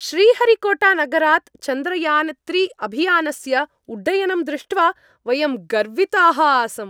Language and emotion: Sanskrit, happy